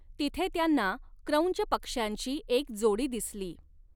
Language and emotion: Marathi, neutral